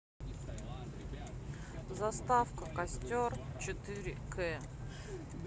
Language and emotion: Russian, neutral